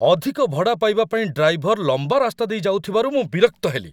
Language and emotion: Odia, angry